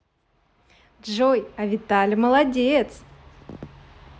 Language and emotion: Russian, positive